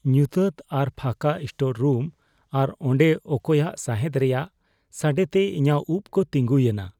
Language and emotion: Santali, fearful